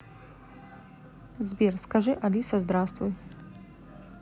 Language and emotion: Russian, neutral